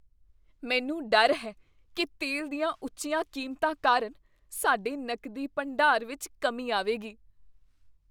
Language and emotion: Punjabi, fearful